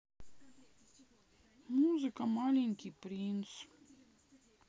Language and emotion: Russian, sad